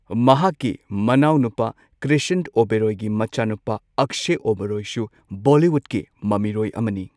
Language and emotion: Manipuri, neutral